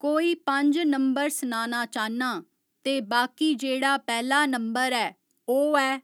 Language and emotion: Dogri, neutral